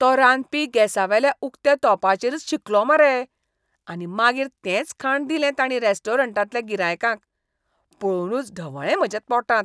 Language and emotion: Goan Konkani, disgusted